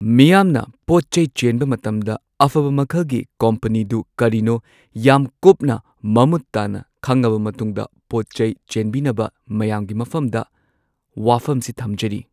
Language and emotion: Manipuri, neutral